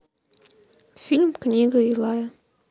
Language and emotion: Russian, neutral